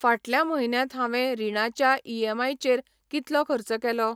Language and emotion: Goan Konkani, neutral